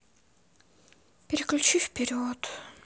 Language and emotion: Russian, sad